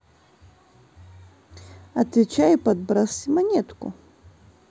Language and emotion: Russian, neutral